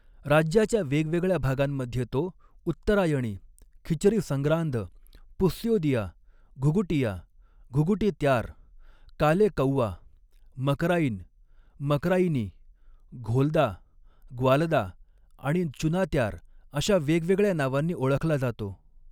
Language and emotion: Marathi, neutral